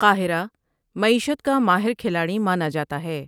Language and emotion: Urdu, neutral